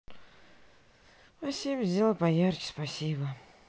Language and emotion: Russian, sad